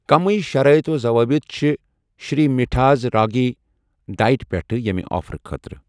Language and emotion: Kashmiri, neutral